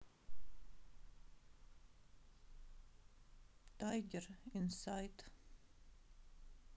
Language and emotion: Russian, sad